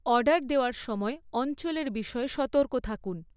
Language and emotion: Bengali, neutral